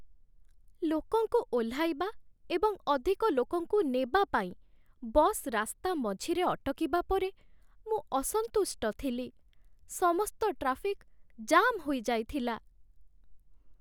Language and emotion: Odia, sad